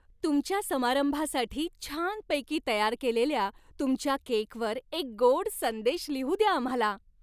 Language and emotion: Marathi, happy